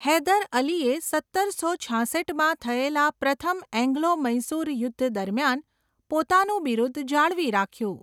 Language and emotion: Gujarati, neutral